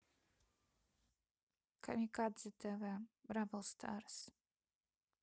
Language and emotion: Russian, neutral